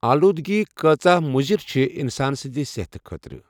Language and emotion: Kashmiri, neutral